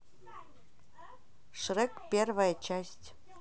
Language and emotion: Russian, neutral